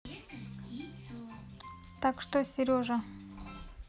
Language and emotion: Russian, neutral